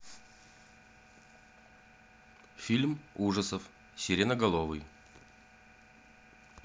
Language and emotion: Russian, neutral